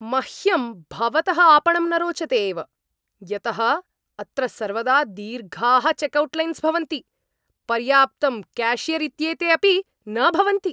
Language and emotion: Sanskrit, angry